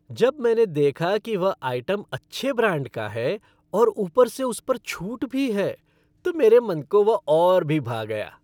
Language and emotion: Hindi, happy